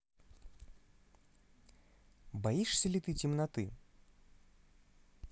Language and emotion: Russian, neutral